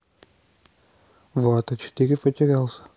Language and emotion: Russian, neutral